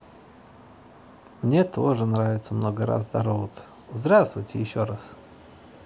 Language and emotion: Russian, positive